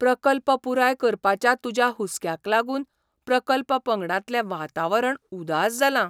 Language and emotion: Goan Konkani, surprised